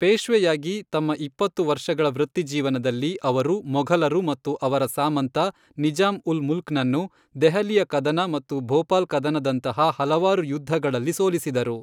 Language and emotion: Kannada, neutral